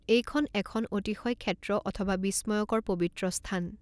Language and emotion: Assamese, neutral